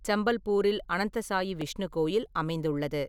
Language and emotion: Tamil, neutral